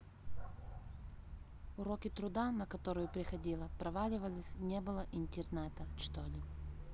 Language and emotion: Russian, neutral